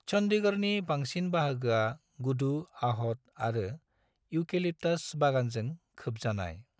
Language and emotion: Bodo, neutral